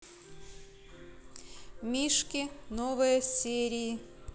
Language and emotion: Russian, neutral